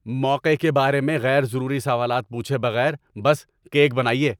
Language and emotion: Urdu, angry